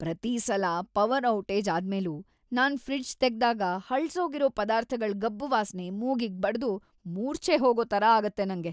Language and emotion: Kannada, disgusted